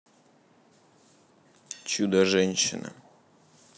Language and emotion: Russian, neutral